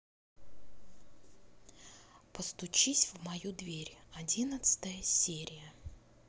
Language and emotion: Russian, neutral